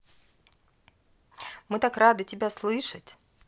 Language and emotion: Russian, positive